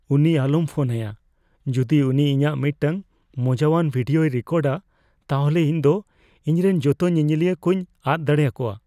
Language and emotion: Santali, fearful